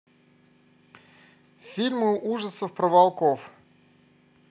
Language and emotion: Russian, neutral